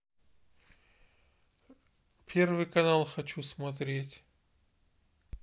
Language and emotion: Russian, neutral